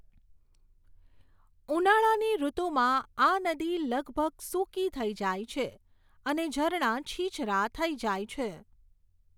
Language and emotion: Gujarati, neutral